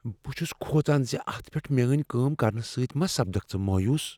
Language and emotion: Kashmiri, fearful